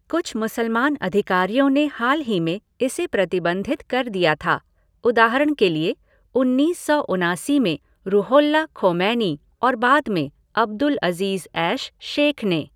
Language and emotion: Hindi, neutral